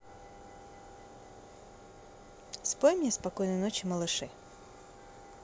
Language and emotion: Russian, positive